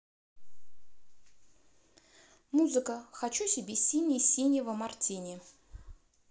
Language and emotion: Russian, neutral